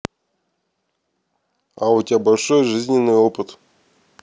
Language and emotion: Russian, neutral